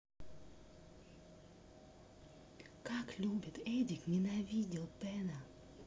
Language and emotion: Russian, neutral